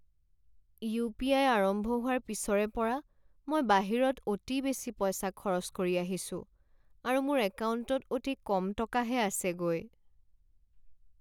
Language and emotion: Assamese, sad